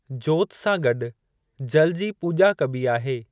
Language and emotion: Sindhi, neutral